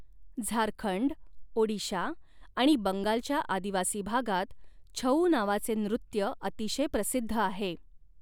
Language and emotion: Marathi, neutral